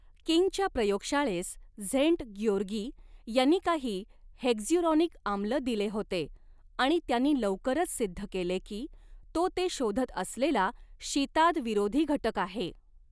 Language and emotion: Marathi, neutral